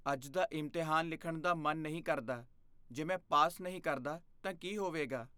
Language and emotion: Punjabi, fearful